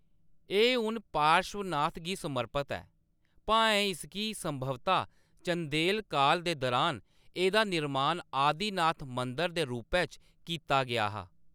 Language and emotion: Dogri, neutral